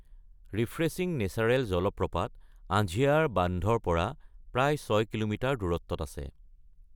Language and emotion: Assamese, neutral